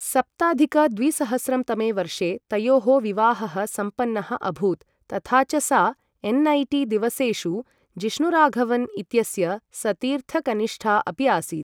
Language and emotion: Sanskrit, neutral